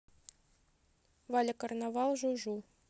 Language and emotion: Russian, neutral